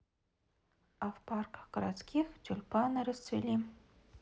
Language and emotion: Russian, neutral